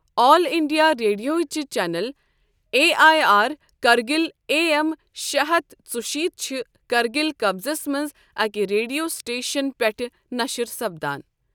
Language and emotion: Kashmiri, neutral